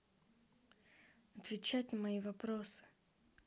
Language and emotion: Russian, neutral